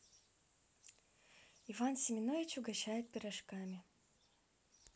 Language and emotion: Russian, neutral